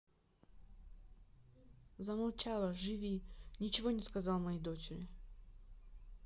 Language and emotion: Russian, neutral